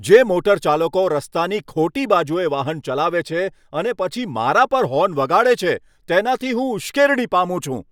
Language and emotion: Gujarati, angry